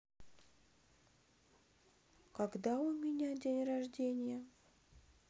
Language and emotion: Russian, neutral